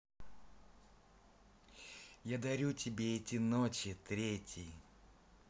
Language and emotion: Russian, positive